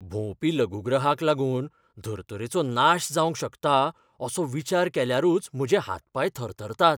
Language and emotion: Goan Konkani, fearful